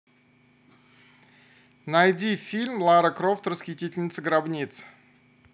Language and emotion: Russian, neutral